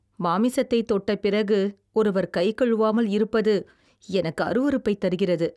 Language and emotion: Tamil, disgusted